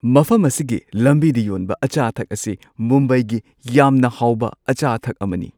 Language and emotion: Manipuri, happy